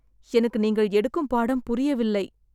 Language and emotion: Tamil, sad